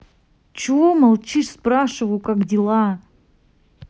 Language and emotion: Russian, angry